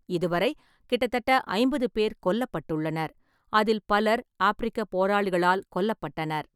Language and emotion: Tamil, neutral